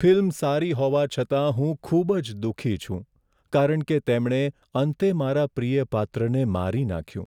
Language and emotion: Gujarati, sad